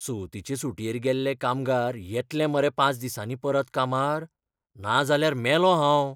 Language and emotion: Goan Konkani, fearful